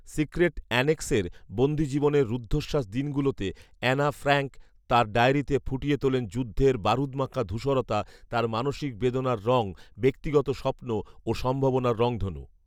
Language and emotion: Bengali, neutral